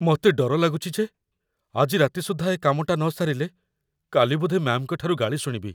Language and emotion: Odia, fearful